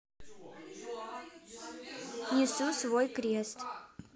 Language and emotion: Russian, neutral